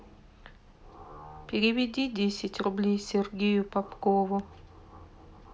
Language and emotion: Russian, sad